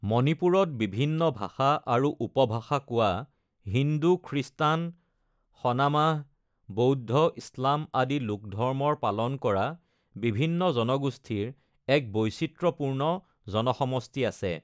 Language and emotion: Assamese, neutral